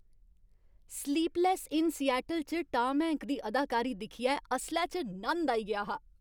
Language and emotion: Dogri, happy